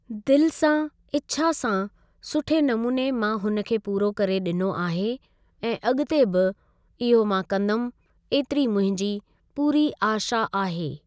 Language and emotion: Sindhi, neutral